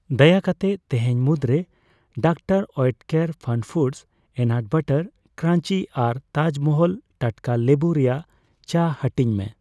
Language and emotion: Santali, neutral